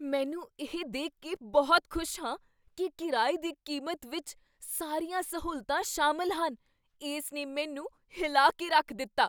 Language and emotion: Punjabi, surprised